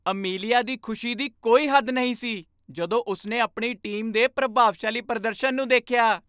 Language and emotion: Punjabi, happy